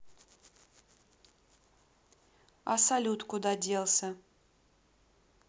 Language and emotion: Russian, neutral